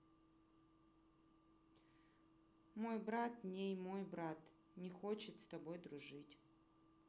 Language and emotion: Russian, sad